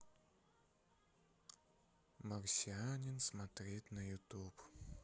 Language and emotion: Russian, sad